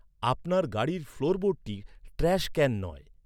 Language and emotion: Bengali, neutral